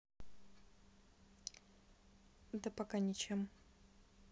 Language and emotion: Russian, neutral